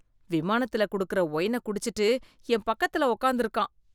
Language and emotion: Tamil, disgusted